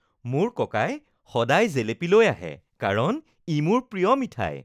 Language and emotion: Assamese, happy